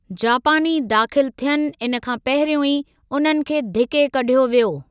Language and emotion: Sindhi, neutral